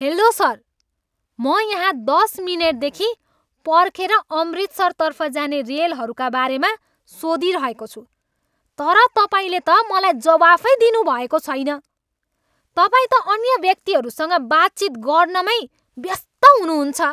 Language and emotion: Nepali, angry